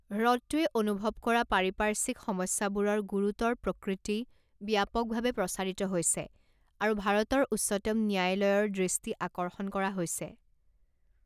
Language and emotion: Assamese, neutral